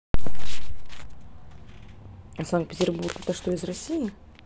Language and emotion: Russian, neutral